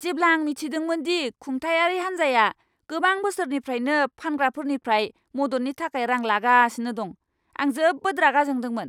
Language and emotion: Bodo, angry